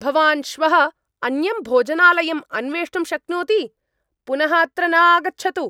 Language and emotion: Sanskrit, angry